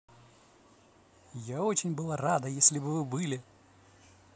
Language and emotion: Russian, positive